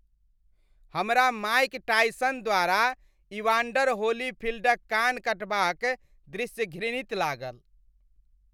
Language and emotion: Maithili, disgusted